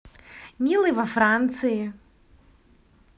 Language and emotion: Russian, positive